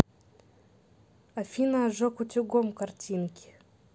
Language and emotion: Russian, neutral